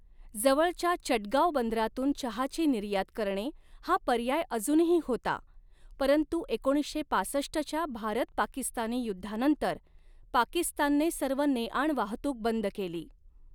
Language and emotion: Marathi, neutral